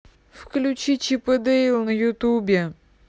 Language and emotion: Russian, neutral